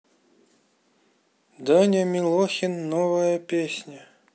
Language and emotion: Russian, neutral